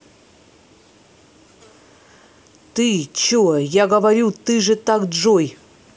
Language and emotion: Russian, angry